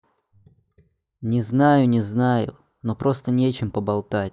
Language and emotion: Russian, neutral